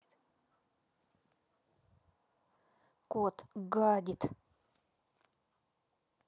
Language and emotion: Russian, angry